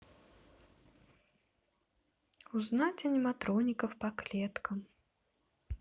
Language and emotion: Russian, neutral